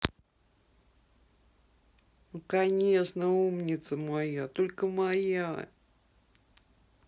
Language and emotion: Russian, positive